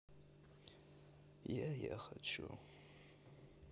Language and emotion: Russian, sad